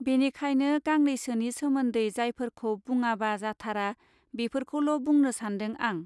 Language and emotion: Bodo, neutral